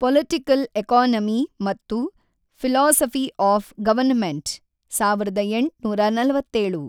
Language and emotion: Kannada, neutral